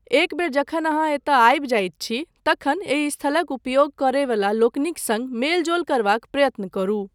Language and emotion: Maithili, neutral